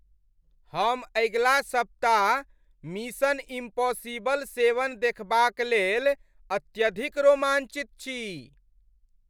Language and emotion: Maithili, happy